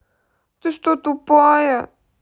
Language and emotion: Russian, sad